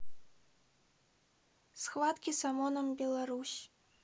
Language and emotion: Russian, neutral